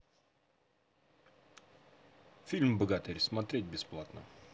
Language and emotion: Russian, neutral